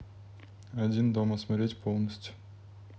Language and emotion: Russian, neutral